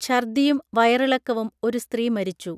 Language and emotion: Malayalam, neutral